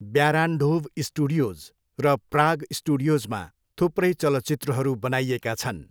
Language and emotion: Nepali, neutral